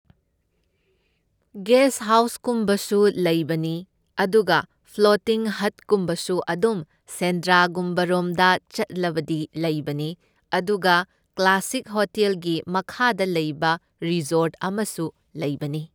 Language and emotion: Manipuri, neutral